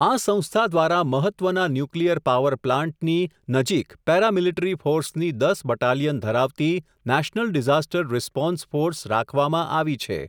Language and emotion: Gujarati, neutral